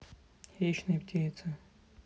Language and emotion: Russian, sad